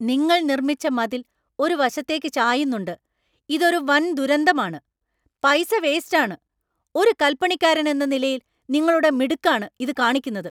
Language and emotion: Malayalam, angry